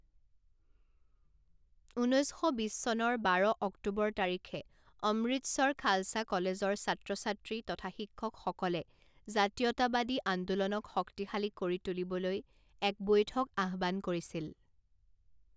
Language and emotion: Assamese, neutral